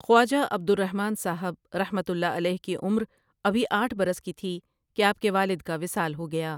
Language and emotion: Urdu, neutral